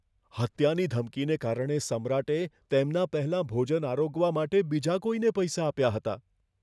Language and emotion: Gujarati, fearful